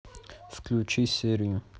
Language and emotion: Russian, neutral